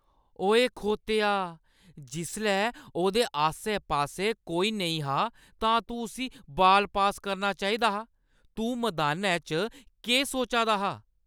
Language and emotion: Dogri, angry